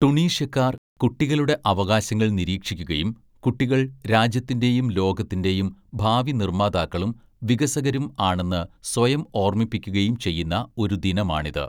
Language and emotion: Malayalam, neutral